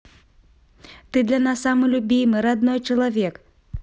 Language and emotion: Russian, positive